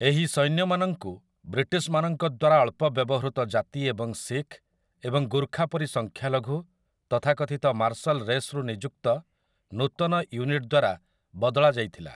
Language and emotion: Odia, neutral